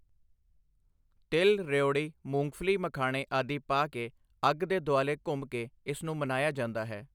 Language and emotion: Punjabi, neutral